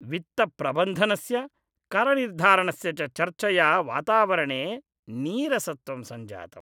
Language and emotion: Sanskrit, disgusted